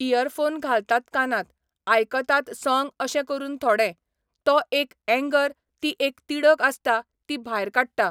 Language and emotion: Goan Konkani, neutral